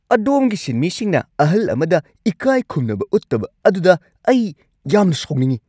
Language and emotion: Manipuri, angry